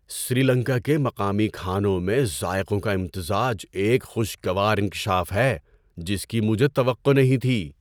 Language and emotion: Urdu, surprised